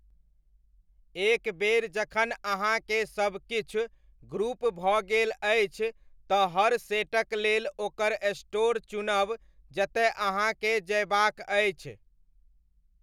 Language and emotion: Maithili, neutral